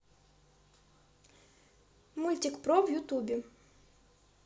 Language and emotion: Russian, neutral